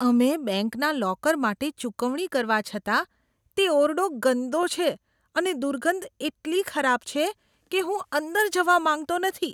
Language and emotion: Gujarati, disgusted